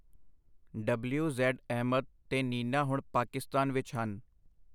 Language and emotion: Punjabi, neutral